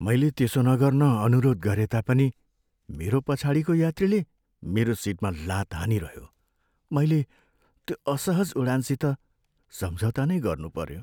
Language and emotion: Nepali, sad